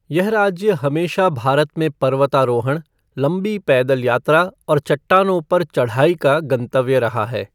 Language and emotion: Hindi, neutral